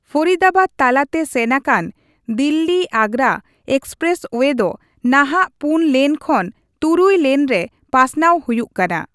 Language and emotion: Santali, neutral